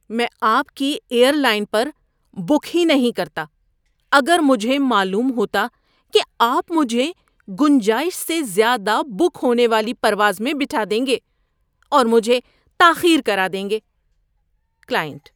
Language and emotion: Urdu, disgusted